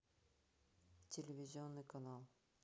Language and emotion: Russian, neutral